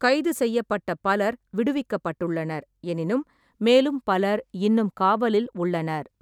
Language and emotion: Tamil, neutral